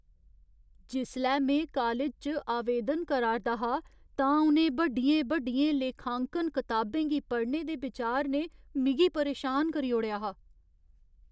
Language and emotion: Dogri, fearful